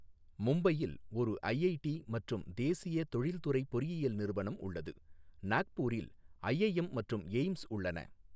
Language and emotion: Tamil, neutral